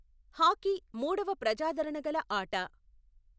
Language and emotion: Telugu, neutral